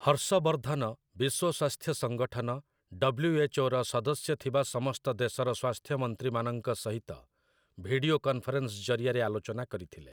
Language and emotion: Odia, neutral